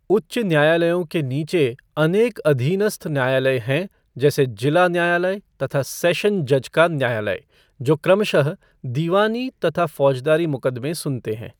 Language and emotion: Hindi, neutral